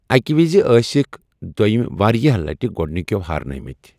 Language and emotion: Kashmiri, neutral